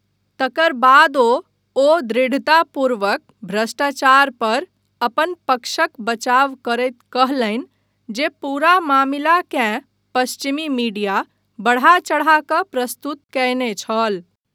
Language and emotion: Maithili, neutral